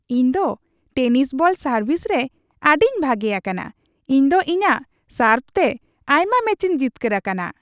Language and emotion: Santali, happy